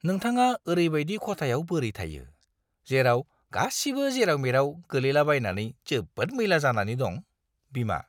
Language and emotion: Bodo, disgusted